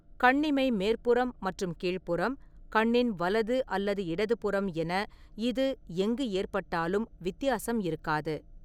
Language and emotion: Tamil, neutral